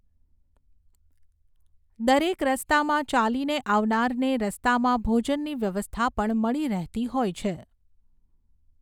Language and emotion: Gujarati, neutral